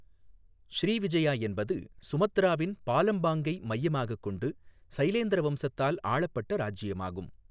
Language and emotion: Tamil, neutral